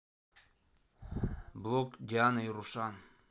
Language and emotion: Russian, neutral